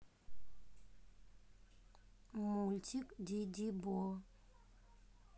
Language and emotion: Russian, neutral